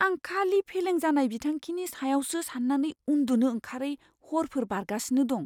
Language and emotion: Bodo, fearful